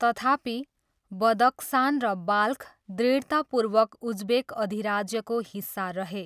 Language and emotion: Nepali, neutral